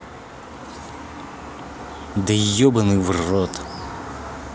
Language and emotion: Russian, angry